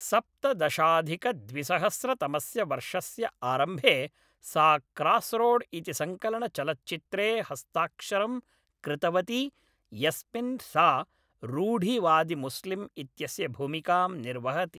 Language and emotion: Sanskrit, neutral